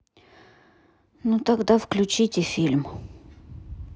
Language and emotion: Russian, sad